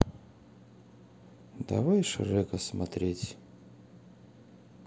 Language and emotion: Russian, neutral